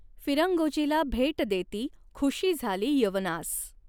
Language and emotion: Marathi, neutral